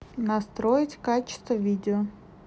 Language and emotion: Russian, neutral